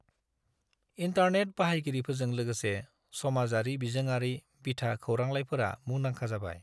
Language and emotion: Bodo, neutral